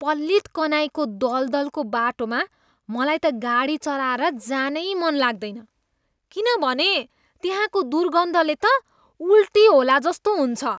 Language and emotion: Nepali, disgusted